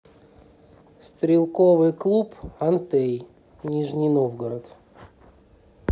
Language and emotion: Russian, neutral